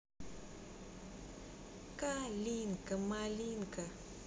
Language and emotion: Russian, positive